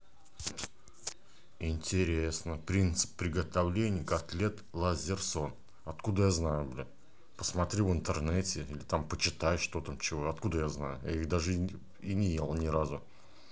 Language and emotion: Russian, angry